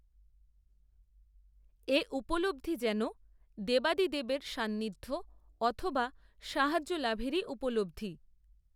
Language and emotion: Bengali, neutral